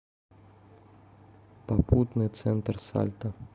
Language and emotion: Russian, neutral